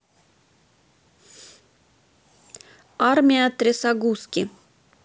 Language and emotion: Russian, neutral